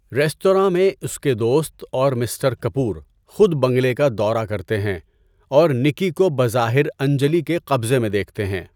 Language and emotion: Urdu, neutral